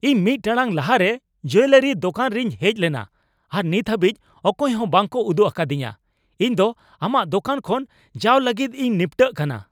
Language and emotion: Santali, angry